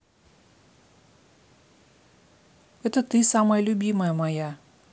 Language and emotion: Russian, neutral